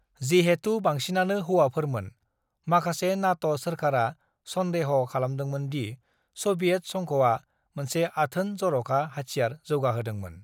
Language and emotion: Bodo, neutral